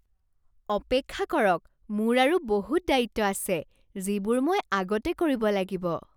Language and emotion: Assamese, surprised